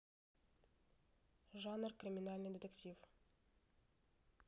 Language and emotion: Russian, neutral